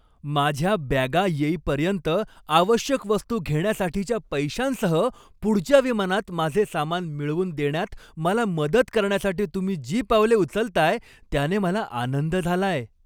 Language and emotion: Marathi, happy